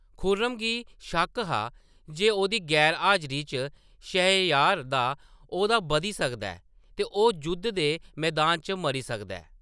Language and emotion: Dogri, neutral